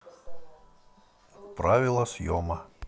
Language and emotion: Russian, neutral